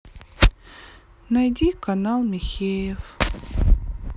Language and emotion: Russian, sad